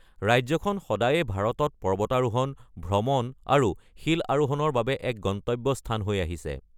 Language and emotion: Assamese, neutral